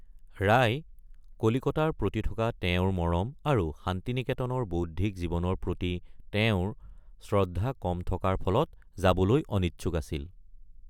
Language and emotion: Assamese, neutral